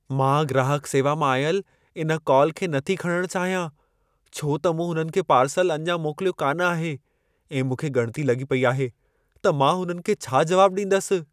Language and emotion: Sindhi, fearful